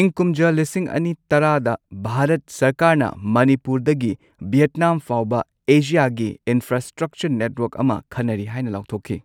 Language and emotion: Manipuri, neutral